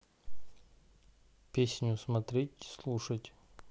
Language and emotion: Russian, neutral